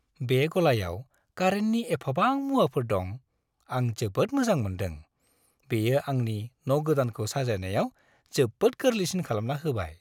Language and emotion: Bodo, happy